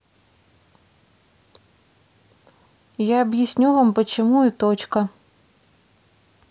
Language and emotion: Russian, neutral